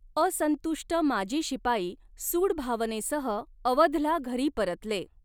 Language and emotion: Marathi, neutral